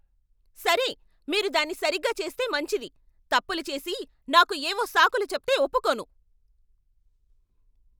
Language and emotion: Telugu, angry